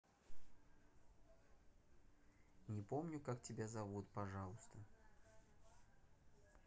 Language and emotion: Russian, neutral